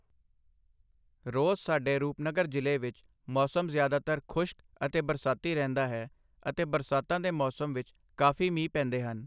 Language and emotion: Punjabi, neutral